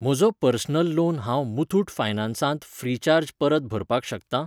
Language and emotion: Goan Konkani, neutral